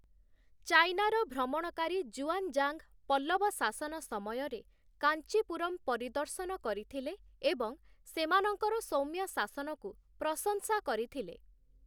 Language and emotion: Odia, neutral